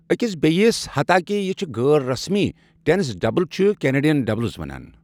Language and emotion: Kashmiri, neutral